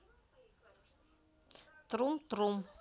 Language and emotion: Russian, neutral